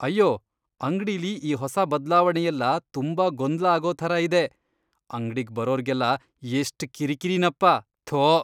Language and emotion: Kannada, disgusted